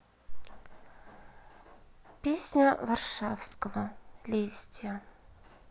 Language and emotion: Russian, neutral